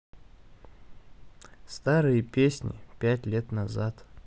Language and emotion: Russian, neutral